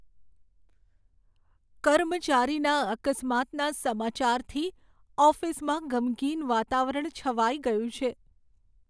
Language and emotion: Gujarati, sad